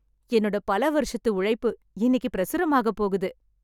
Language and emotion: Tamil, happy